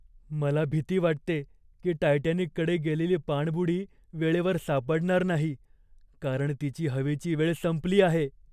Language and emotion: Marathi, fearful